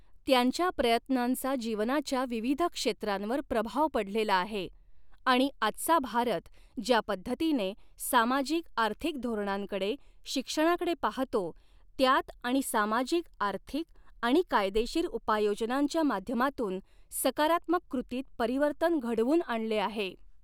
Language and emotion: Marathi, neutral